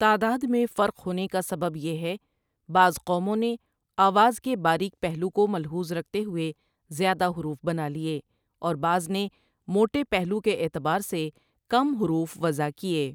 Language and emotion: Urdu, neutral